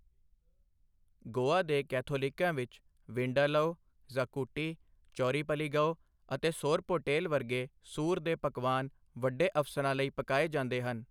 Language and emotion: Punjabi, neutral